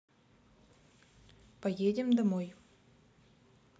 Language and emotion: Russian, neutral